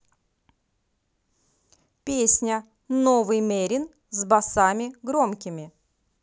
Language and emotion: Russian, positive